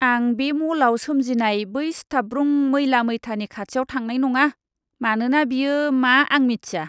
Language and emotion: Bodo, disgusted